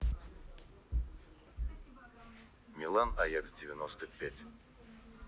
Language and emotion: Russian, neutral